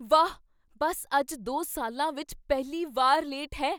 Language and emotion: Punjabi, surprised